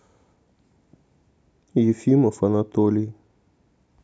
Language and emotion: Russian, neutral